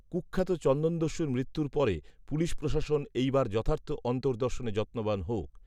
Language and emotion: Bengali, neutral